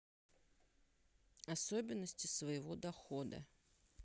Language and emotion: Russian, neutral